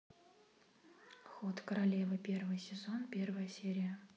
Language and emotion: Russian, neutral